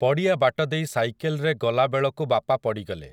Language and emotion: Odia, neutral